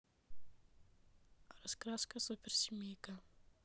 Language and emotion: Russian, neutral